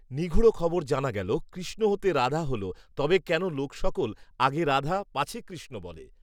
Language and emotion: Bengali, neutral